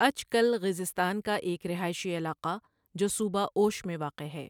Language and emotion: Urdu, neutral